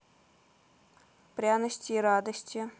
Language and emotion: Russian, neutral